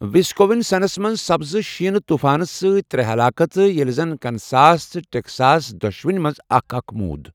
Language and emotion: Kashmiri, neutral